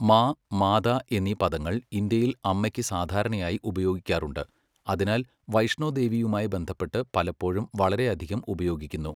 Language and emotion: Malayalam, neutral